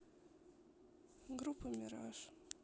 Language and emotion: Russian, sad